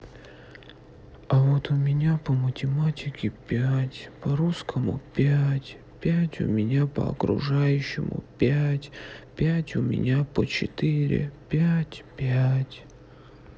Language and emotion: Russian, sad